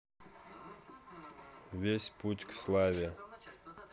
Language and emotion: Russian, neutral